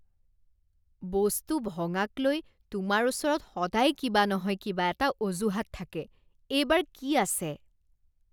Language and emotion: Assamese, disgusted